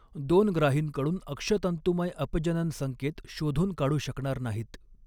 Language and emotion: Marathi, neutral